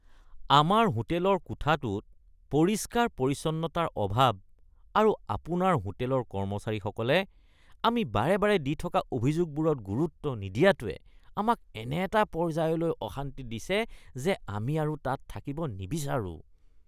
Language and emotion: Assamese, disgusted